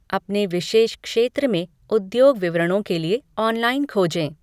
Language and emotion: Hindi, neutral